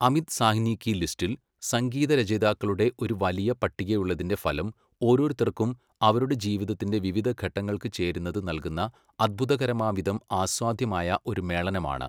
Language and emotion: Malayalam, neutral